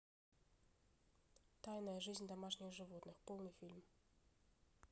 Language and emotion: Russian, neutral